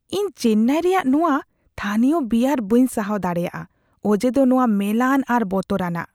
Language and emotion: Santali, disgusted